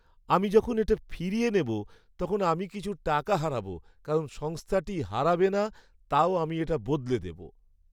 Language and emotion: Bengali, sad